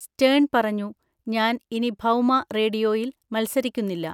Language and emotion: Malayalam, neutral